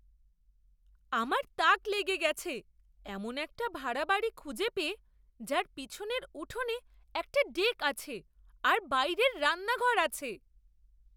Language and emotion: Bengali, surprised